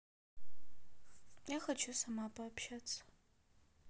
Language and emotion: Russian, sad